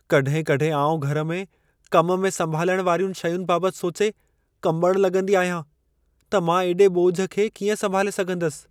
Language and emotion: Sindhi, fearful